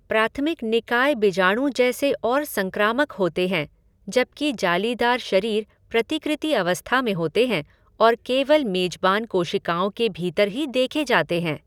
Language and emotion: Hindi, neutral